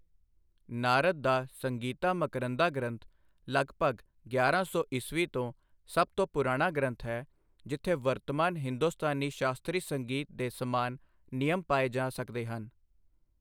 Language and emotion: Punjabi, neutral